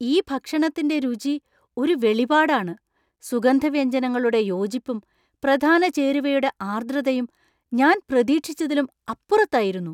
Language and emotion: Malayalam, surprised